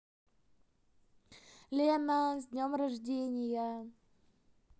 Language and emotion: Russian, positive